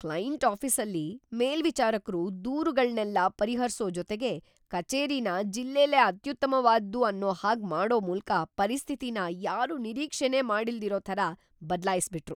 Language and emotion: Kannada, surprised